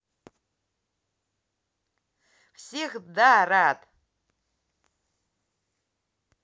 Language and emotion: Russian, positive